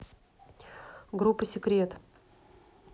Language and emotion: Russian, neutral